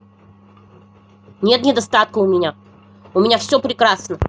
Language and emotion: Russian, angry